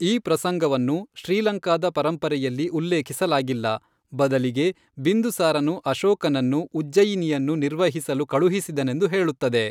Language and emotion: Kannada, neutral